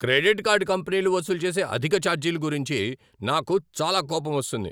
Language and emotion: Telugu, angry